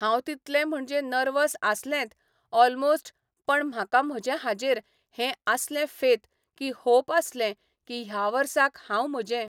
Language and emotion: Goan Konkani, neutral